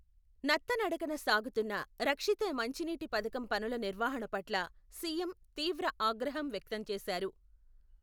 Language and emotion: Telugu, neutral